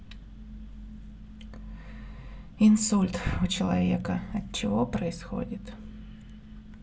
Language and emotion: Russian, sad